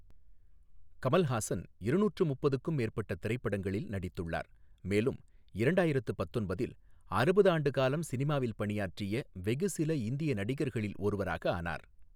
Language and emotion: Tamil, neutral